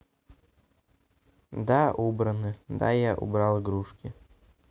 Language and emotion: Russian, neutral